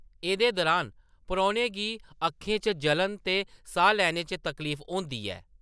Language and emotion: Dogri, neutral